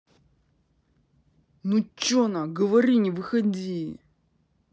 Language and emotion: Russian, angry